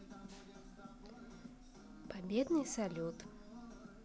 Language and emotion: Russian, neutral